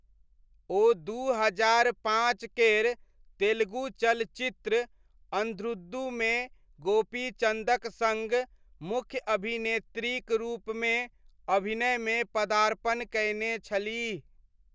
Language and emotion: Maithili, neutral